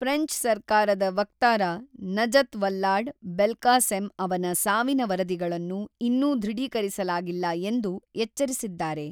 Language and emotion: Kannada, neutral